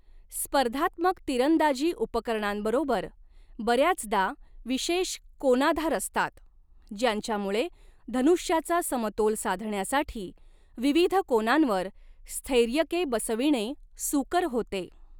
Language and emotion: Marathi, neutral